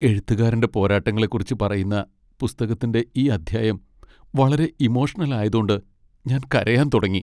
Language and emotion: Malayalam, sad